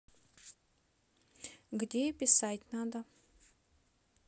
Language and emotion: Russian, neutral